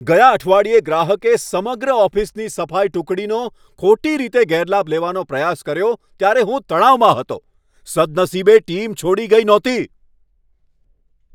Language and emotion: Gujarati, angry